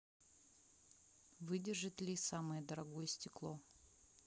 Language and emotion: Russian, neutral